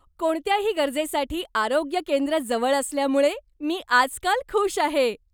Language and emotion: Marathi, happy